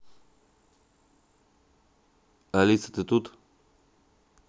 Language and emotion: Russian, neutral